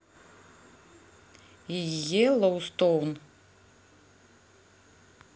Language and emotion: Russian, neutral